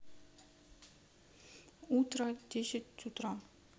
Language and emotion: Russian, neutral